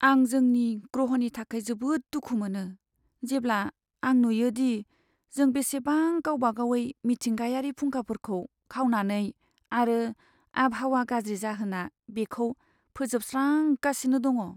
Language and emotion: Bodo, sad